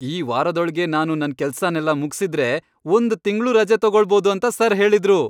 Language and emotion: Kannada, happy